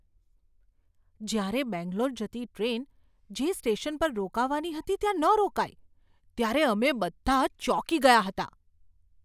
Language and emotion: Gujarati, surprised